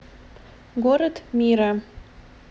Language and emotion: Russian, neutral